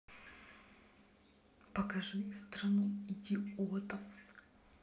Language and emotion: Russian, neutral